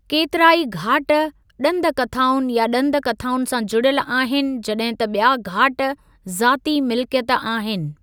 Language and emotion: Sindhi, neutral